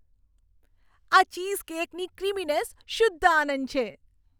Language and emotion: Gujarati, happy